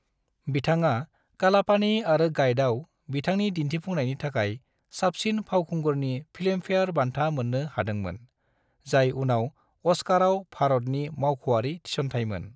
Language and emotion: Bodo, neutral